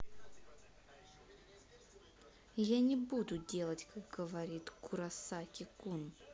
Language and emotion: Russian, angry